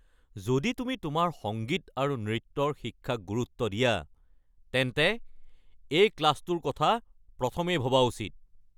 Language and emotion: Assamese, angry